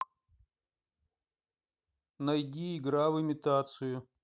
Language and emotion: Russian, neutral